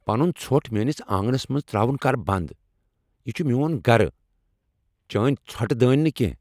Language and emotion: Kashmiri, angry